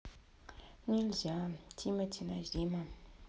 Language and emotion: Russian, sad